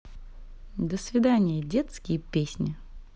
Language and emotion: Russian, neutral